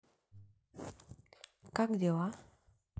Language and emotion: Russian, neutral